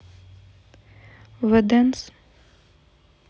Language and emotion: Russian, neutral